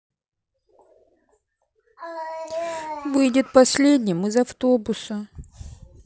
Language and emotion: Russian, sad